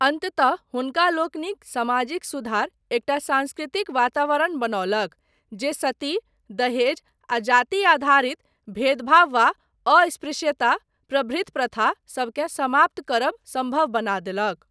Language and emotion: Maithili, neutral